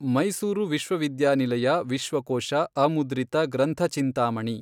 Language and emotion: Kannada, neutral